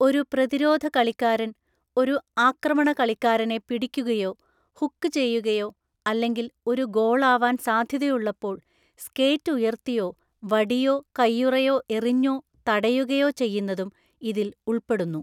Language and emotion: Malayalam, neutral